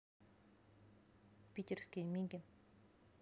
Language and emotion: Russian, neutral